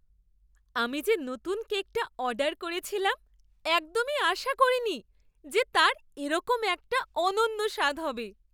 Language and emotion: Bengali, surprised